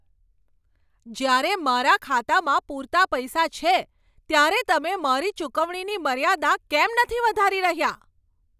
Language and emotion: Gujarati, angry